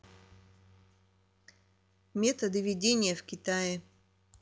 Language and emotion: Russian, neutral